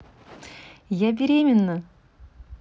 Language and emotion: Russian, positive